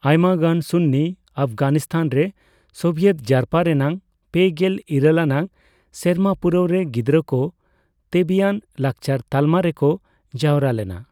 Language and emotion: Santali, neutral